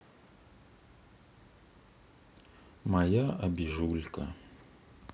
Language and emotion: Russian, sad